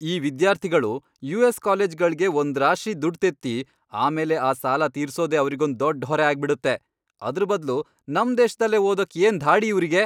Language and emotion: Kannada, angry